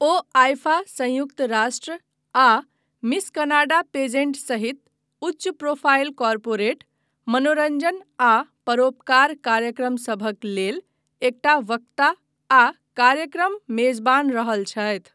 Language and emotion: Maithili, neutral